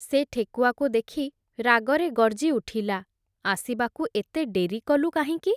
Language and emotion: Odia, neutral